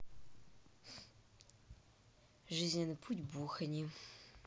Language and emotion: Russian, neutral